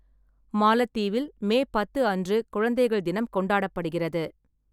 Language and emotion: Tamil, neutral